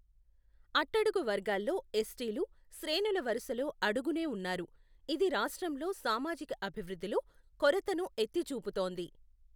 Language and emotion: Telugu, neutral